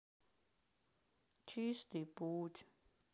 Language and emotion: Russian, sad